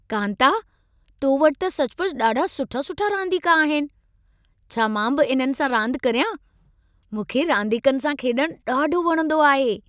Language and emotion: Sindhi, happy